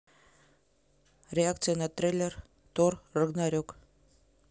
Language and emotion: Russian, neutral